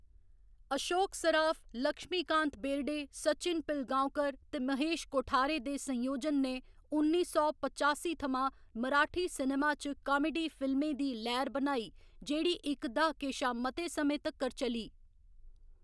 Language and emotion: Dogri, neutral